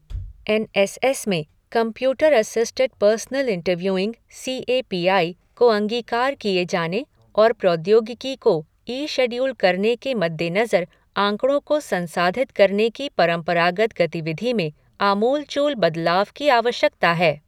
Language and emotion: Hindi, neutral